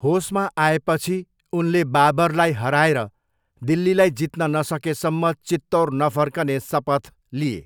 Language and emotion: Nepali, neutral